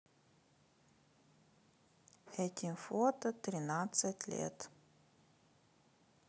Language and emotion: Russian, neutral